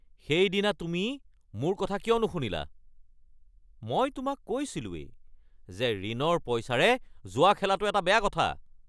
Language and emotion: Assamese, angry